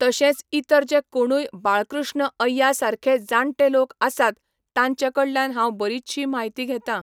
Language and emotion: Goan Konkani, neutral